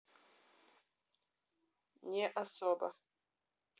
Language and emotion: Russian, neutral